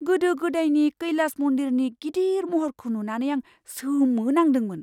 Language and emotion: Bodo, surprised